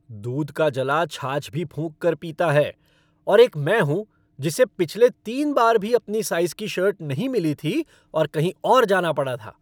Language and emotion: Hindi, angry